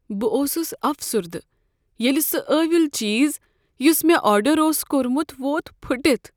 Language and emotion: Kashmiri, sad